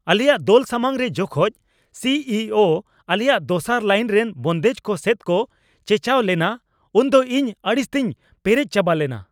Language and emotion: Santali, angry